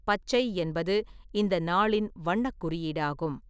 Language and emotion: Tamil, neutral